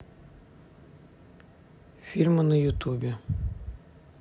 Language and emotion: Russian, neutral